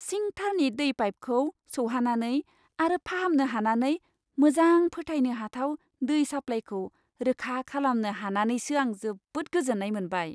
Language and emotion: Bodo, happy